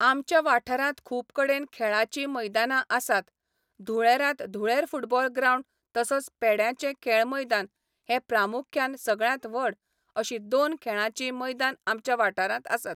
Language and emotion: Goan Konkani, neutral